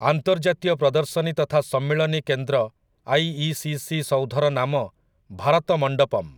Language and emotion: Odia, neutral